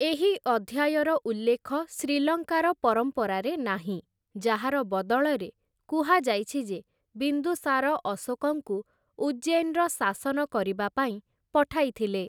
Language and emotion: Odia, neutral